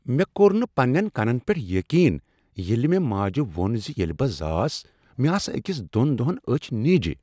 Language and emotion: Kashmiri, surprised